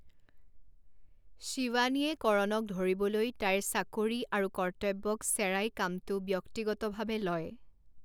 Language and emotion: Assamese, neutral